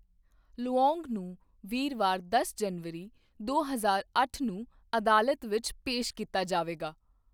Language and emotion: Punjabi, neutral